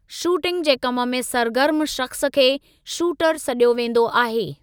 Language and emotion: Sindhi, neutral